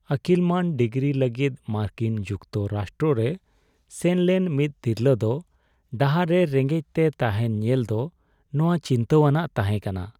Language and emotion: Santali, sad